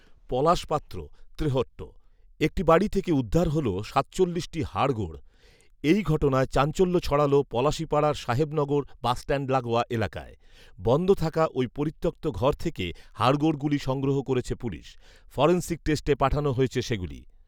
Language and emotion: Bengali, neutral